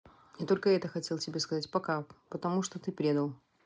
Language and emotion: Russian, neutral